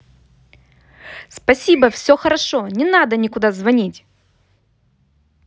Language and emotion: Russian, angry